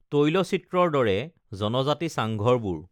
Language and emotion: Assamese, neutral